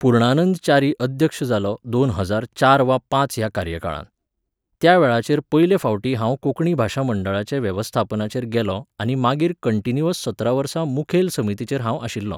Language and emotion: Goan Konkani, neutral